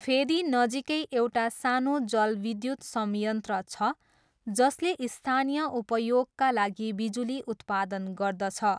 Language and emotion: Nepali, neutral